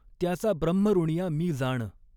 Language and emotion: Marathi, neutral